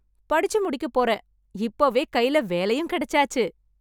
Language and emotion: Tamil, happy